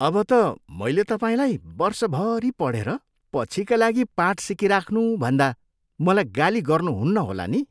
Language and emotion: Nepali, disgusted